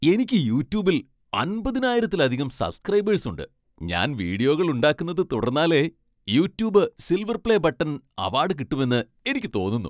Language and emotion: Malayalam, happy